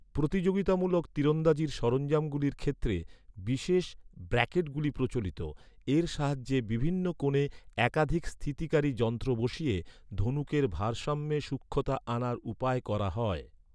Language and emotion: Bengali, neutral